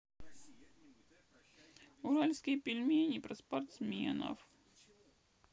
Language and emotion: Russian, sad